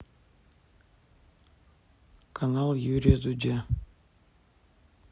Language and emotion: Russian, neutral